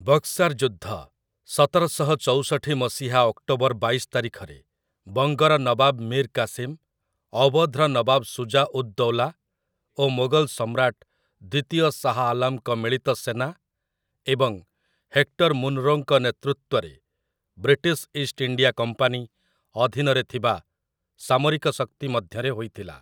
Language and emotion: Odia, neutral